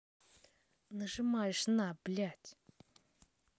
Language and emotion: Russian, angry